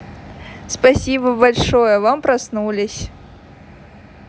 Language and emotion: Russian, positive